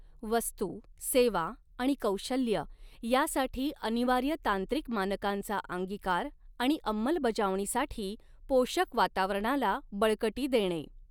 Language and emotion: Marathi, neutral